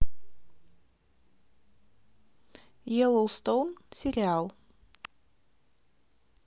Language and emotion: Russian, neutral